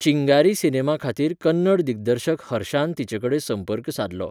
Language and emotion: Goan Konkani, neutral